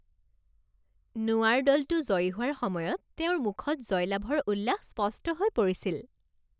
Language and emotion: Assamese, happy